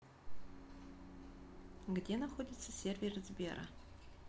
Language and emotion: Russian, neutral